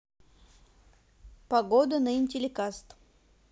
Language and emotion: Russian, neutral